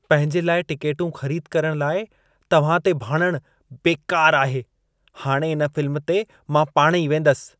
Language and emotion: Sindhi, disgusted